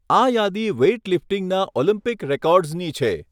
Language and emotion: Gujarati, neutral